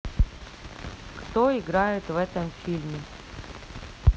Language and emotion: Russian, neutral